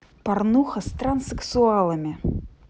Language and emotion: Russian, neutral